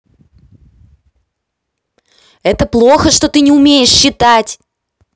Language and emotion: Russian, angry